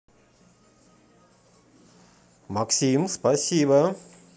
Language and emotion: Russian, positive